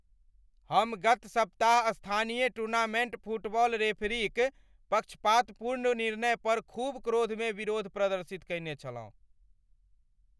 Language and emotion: Maithili, angry